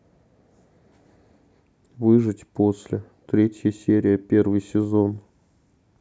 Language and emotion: Russian, sad